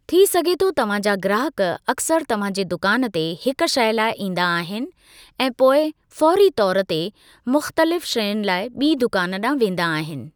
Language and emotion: Sindhi, neutral